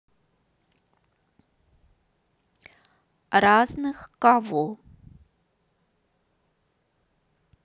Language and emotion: Russian, neutral